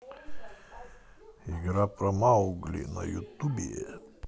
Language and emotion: Russian, positive